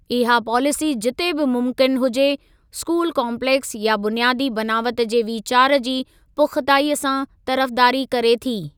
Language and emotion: Sindhi, neutral